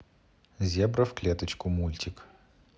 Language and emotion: Russian, neutral